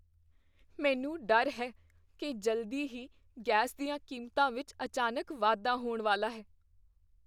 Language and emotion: Punjabi, fearful